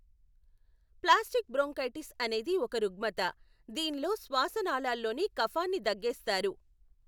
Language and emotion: Telugu, neutral